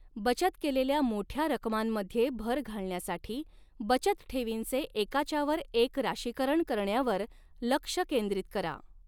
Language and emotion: Marathi, neutral